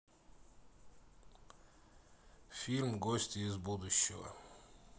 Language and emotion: Russian, neutral